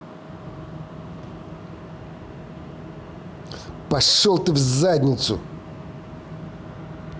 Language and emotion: Russian, angry